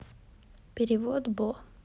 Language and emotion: Russian, neutral